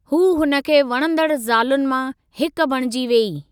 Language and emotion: Sindhi, neutral